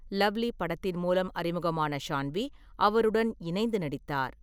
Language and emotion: Tamil, neutral